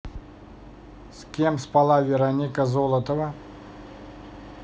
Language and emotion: Russian, neutral